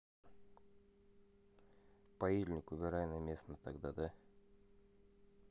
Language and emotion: Russian, neutral